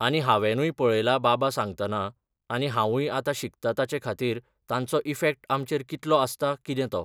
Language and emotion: Goan Konkani, neutral